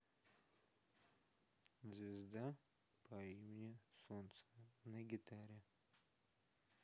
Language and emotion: Russian, sad